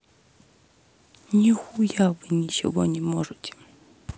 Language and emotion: Russian, sad